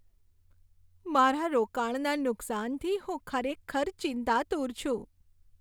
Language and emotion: Gujarati, sad